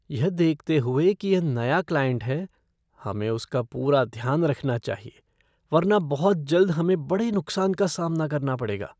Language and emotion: Hindi, fearful